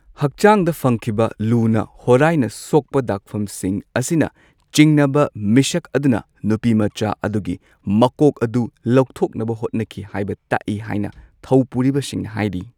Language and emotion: Manipuri, neutral